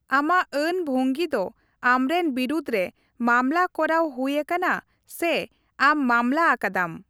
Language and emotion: Santali, neutral